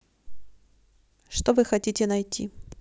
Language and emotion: Russian, neutral